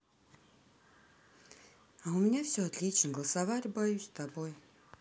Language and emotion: Russian, neutral